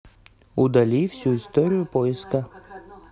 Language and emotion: Russian, neutral